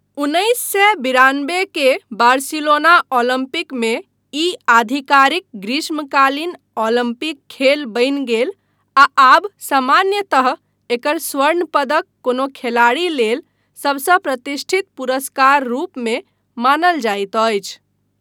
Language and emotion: Maithili, neutral